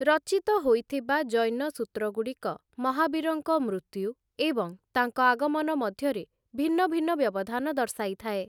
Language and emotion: Odia, neutral